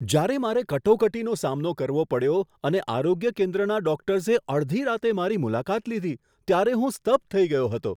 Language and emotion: Gujarati, surprised